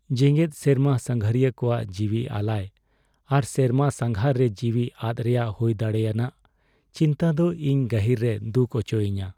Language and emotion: Santali, sad